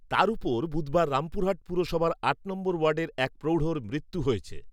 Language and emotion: Bengali, neutral